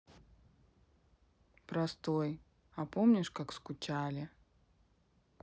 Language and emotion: Russian, sad